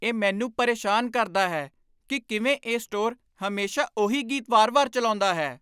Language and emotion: Punjabi, angry